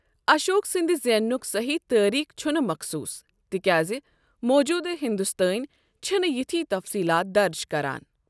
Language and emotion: Kashmiri, neutral